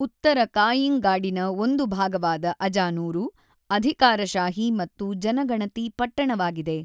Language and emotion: Kannada, neutral